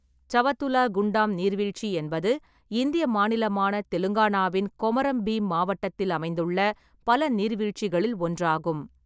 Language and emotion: Tamil, neutral